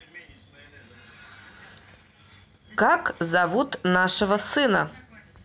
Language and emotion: Russian, neutral